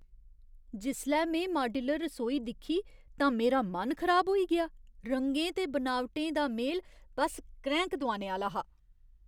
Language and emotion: Dogri, disgusted